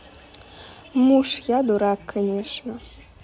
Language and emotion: Russian, neutral